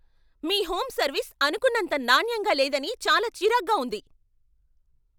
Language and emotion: Telugu, angry